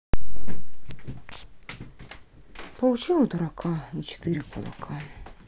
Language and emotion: Russian, sad